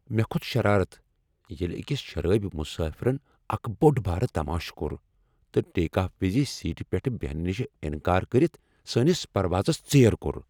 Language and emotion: Kashmiri, angry